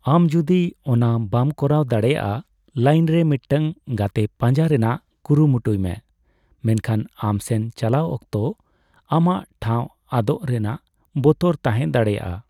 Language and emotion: Santali, neutral